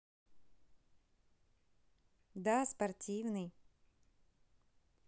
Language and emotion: Russian, positive